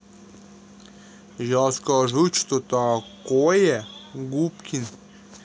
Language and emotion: Russian, neutral